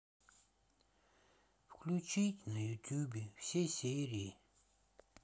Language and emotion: Russian, sad